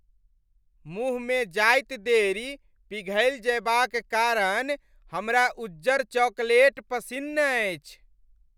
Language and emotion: Maithili, happy